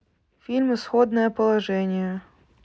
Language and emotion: Russian, neutral